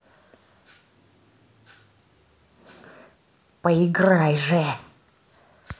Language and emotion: Russian, angry